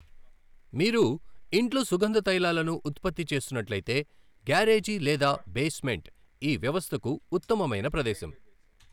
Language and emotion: Telugu, neutral